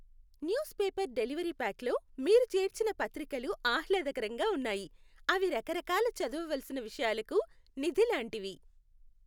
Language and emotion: Telugu, happy